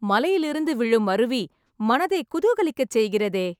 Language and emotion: Tamil, happy